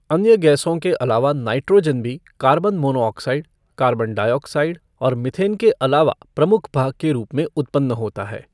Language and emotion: Hindi, neutral